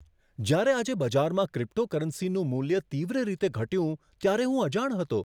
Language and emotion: Gujarati, surprised